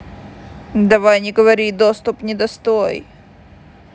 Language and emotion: Russian, neutral